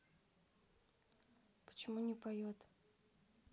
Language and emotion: Russian, neutral